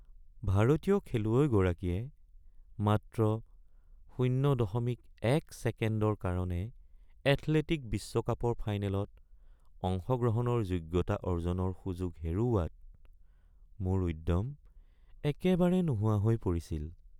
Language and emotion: Assamese, sad